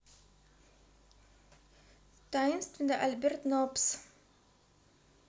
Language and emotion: Russian, neutral